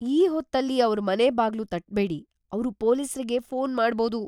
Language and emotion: Kannada, fearful